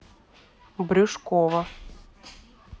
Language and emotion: Russian, neutral